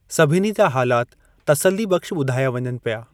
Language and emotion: Sindhi, neutral